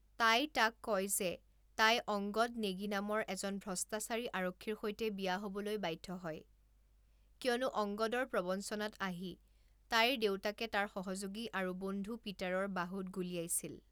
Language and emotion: Assamese, neutral